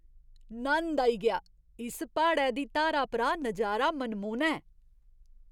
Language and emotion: Dogri, surprised